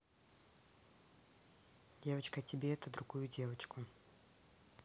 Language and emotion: Russian, neutral